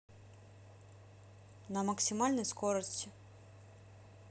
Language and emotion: Russian, neutral